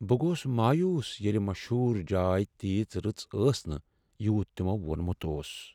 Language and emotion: Kashmiri, sad